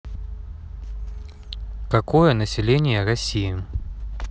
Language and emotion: Russian, neutral